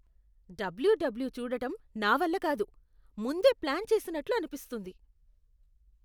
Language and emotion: Telugu, disgusted